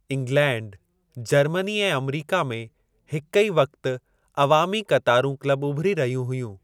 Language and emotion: Sindhi, neutral